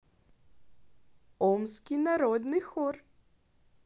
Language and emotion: Russian, positive